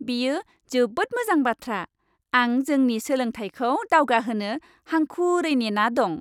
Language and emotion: Bodo, happy